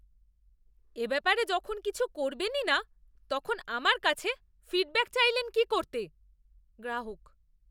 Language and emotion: Bengali, disgusted